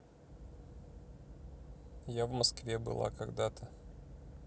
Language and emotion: Russian, neutral